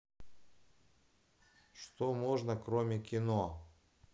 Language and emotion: Russian, neutral